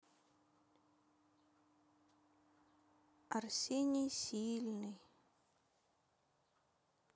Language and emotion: Russian, sad